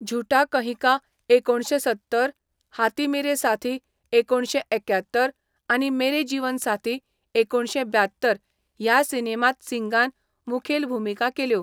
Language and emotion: Goan Konkani, neutral